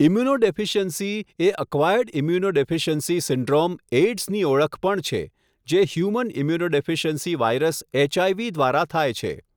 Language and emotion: Gujarati, neutral